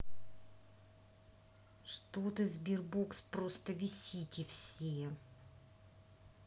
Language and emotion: Russian, angry